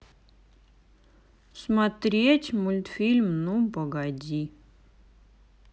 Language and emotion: Russian, sad